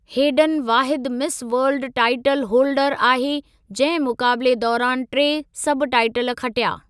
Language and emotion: Sindhi, neutral